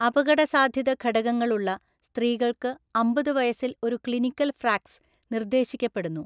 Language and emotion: Malayalam, neutral